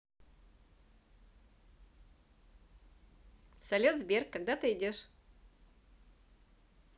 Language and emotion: Russian, positive